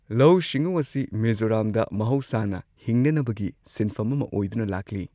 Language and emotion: Manipuri, neutral